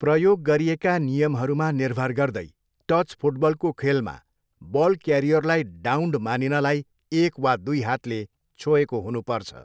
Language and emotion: Nepali, neutral